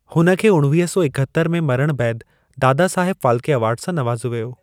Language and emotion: Sindhi, neutral